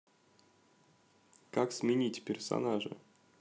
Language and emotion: Russian, neutral